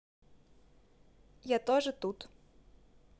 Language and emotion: Russian, neutral